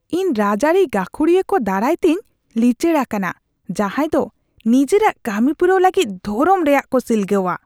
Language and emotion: Santali, disgusted